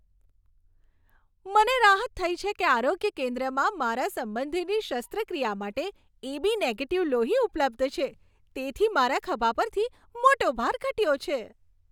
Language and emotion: Gujarati, happy